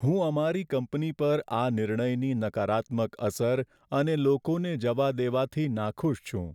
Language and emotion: Gujarati, sad